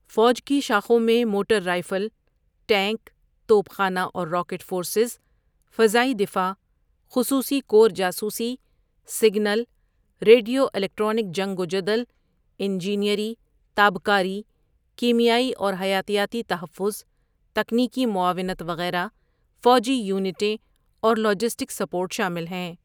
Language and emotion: Urdu, neutral